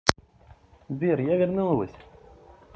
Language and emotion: Russian, positive